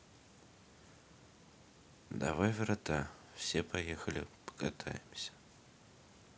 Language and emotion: Russian, neutral